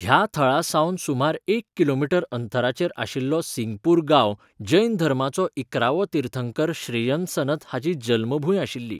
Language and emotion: Goan Konkani, neutral